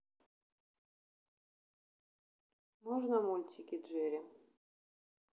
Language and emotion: Russian, neutral